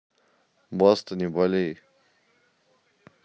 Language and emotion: Russian, neutral